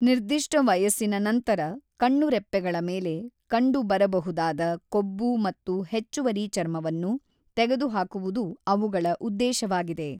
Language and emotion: Kannada, neutral